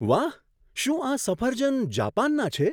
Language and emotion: Gujarati, surprised